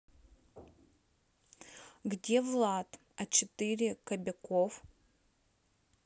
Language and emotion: Russian, neutral